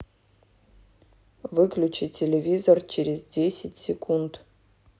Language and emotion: Russian, neutral